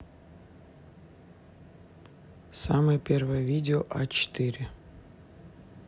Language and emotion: Russian, neutral